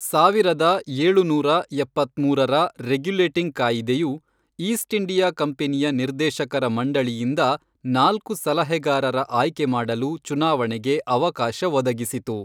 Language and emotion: Kannada, neutral